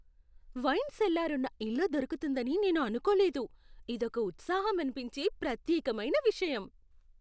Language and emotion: Telugu, surprised